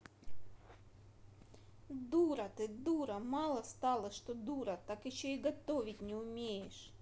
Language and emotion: Russian, angry